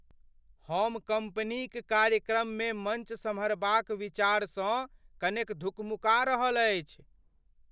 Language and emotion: Maithili, fearful